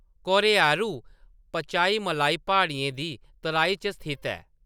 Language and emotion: Dogri, neutral